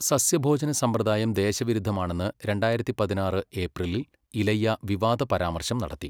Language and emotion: Malayalam, neutral